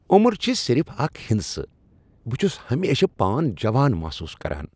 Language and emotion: Kashmiri, happy